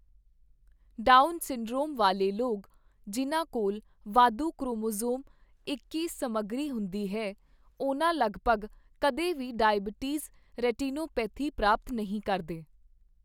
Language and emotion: Punjabi, neutral